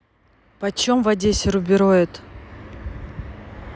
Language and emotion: Russian, neutral